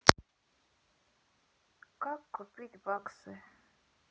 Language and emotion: Russian, neutral